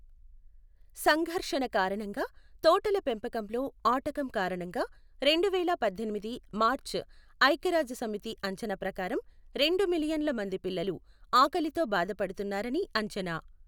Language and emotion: Telugu, neutral